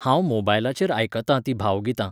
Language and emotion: Goan Konkani, neutral